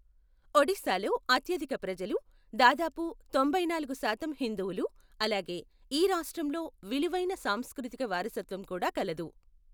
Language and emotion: Telugu, neutral